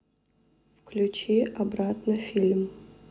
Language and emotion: Russian, neutral